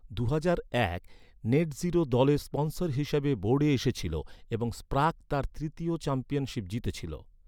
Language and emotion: Bengali, neutral